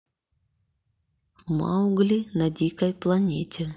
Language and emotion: Russian, neutral